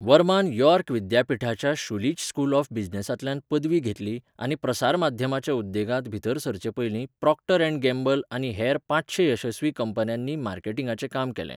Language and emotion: Goan Konkani, neutral